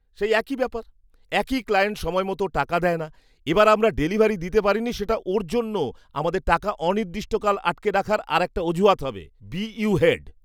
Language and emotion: Bengali, disgusted